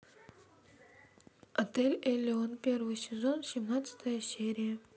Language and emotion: Russian, neutral